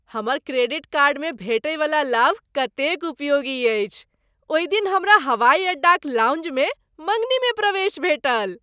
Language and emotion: Maithili, happy